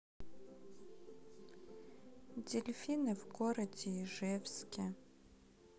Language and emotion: Russian, sad